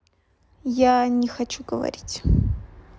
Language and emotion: Russian, neutral